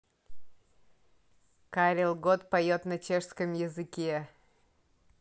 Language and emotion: Russian, positive